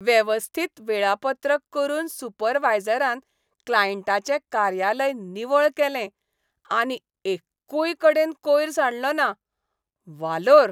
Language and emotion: Goan Konkani, happy